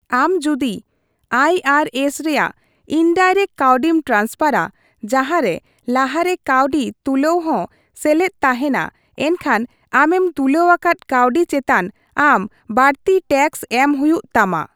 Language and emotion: Santali, neutral